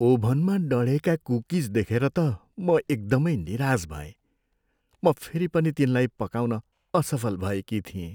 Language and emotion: Nepali, sad